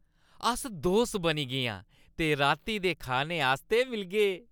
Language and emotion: Dogri, happy